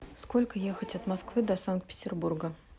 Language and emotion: Russian, neutral